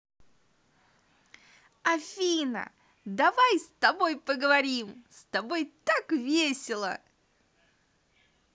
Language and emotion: Russian, positive